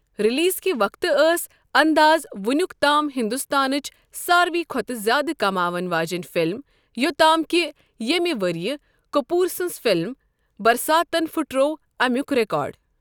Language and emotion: Kashmiri, neutral